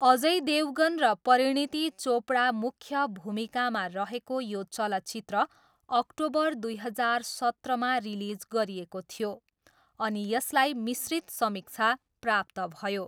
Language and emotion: Nepali, neutral